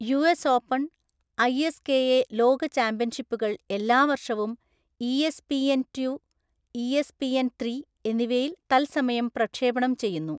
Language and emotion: Malayalam, neutral